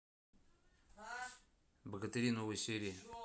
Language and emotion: Russian, neutral